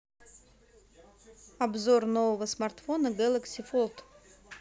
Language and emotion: Russian, neutral